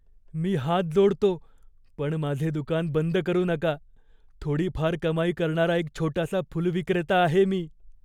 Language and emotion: Marathi, fearful